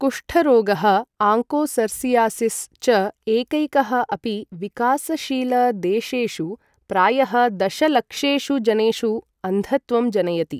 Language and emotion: Sanskrit, neutral